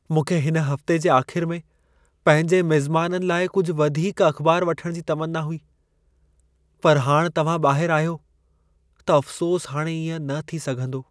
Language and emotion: Sindhi, sad